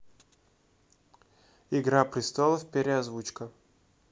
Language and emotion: Russian, neutral